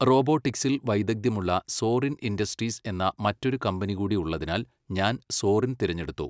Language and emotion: Malayalam, neutral